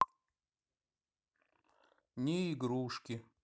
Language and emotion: Russian, sad